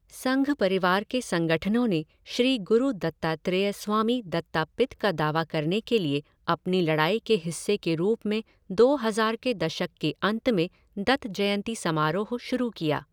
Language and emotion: Hindi, neutral